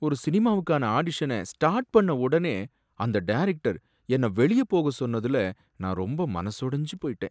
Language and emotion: Tamil, sad